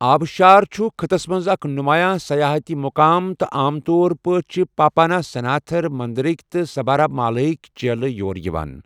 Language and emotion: Kashmiri, neutral